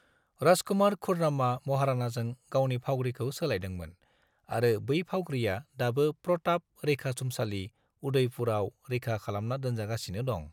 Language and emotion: Bodo, neutral